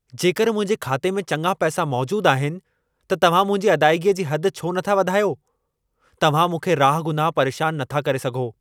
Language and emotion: Sindhi, angry